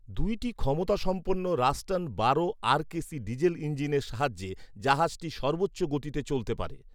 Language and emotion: Bengali, neutral